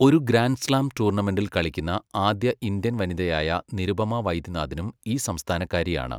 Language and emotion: Malayalam, neutral